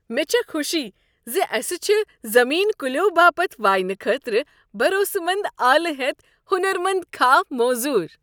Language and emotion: Kashmiri, happy